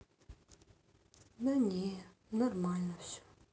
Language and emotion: Russian, sad